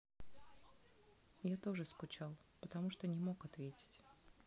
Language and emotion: Russian, neutral